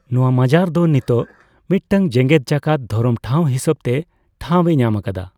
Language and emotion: Santali, neutral